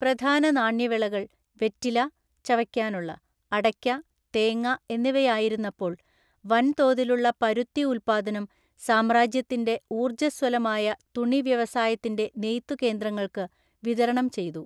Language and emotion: Malayalam, neutral